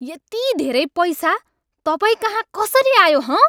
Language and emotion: Nepali, angry